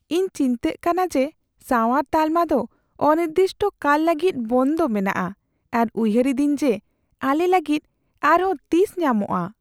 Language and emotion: Santali, fearful